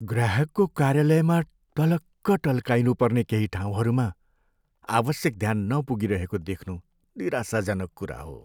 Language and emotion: Nepali, sad